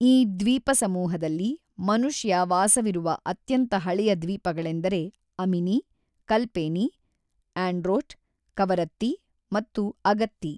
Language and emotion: Kannada, neutral